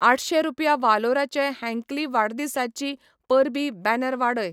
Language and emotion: Goan Konkani, neutral